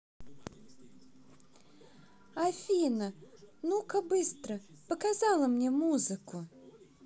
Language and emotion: Russian, neutral